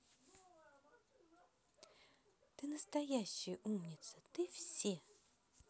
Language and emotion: Russian, positive